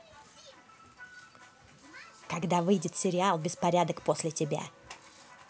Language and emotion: Russian, neutral